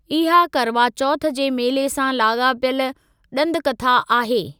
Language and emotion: Sindhi, neutral